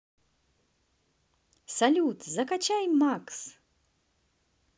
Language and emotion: Russian, positive